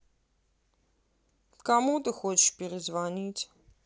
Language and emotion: Russian, angry